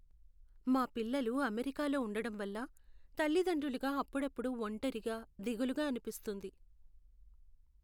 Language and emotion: Telugu, sad